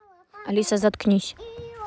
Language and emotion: Russian, neutral